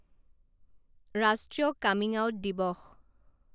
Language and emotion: Assamese, neutral